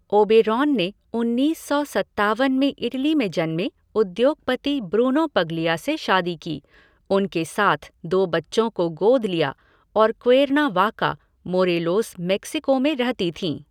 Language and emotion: Hindi, neutral